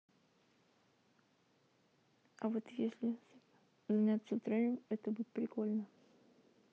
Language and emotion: Russian, neutral